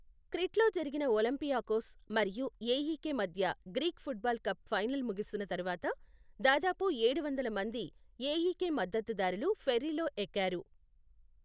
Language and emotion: Telugu, neutral